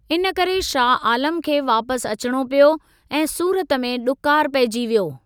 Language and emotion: Sindhi, neutral